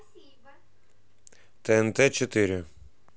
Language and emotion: Russian, neutral